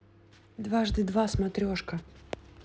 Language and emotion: Russian, neutral